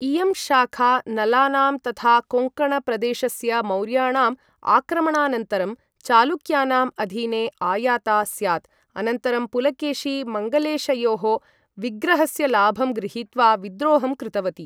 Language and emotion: Sanskrit, neutral